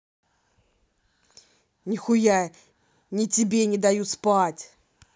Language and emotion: Russian, angry